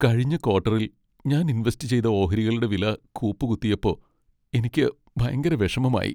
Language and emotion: Malayalam, sad